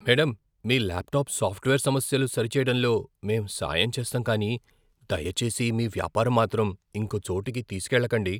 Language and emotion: Telugu, fearful